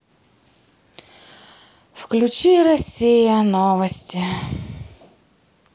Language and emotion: Russian, sad